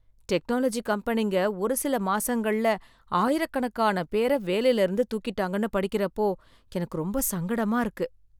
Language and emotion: Tamil, sad